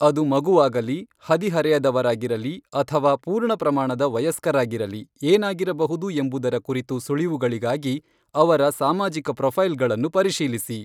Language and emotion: Kannada, neutral